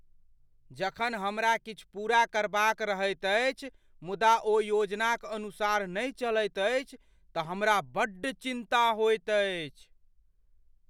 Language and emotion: Maithili, fearful